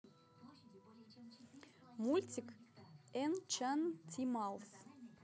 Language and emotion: Russian, neutral